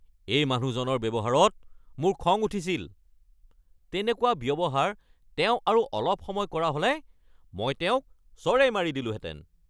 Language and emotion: Assamese, angry